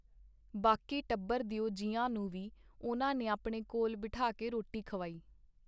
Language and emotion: Punjabi, neutral